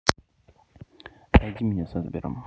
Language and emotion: Russian, neutral